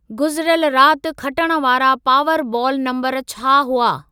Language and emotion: Sindhi, neutral